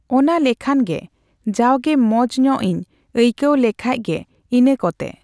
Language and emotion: Santali, neutral